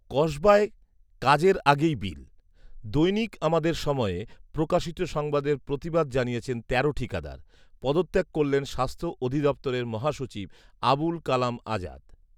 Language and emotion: Bengali, neutral